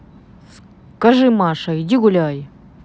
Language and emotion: Russian, neutral